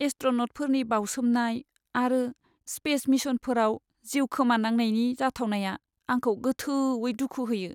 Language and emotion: Bodo, sad